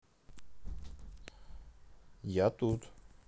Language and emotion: Russian, neutral